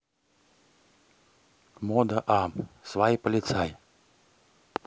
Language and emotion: Russian, neutral